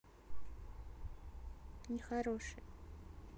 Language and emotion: Russian, sad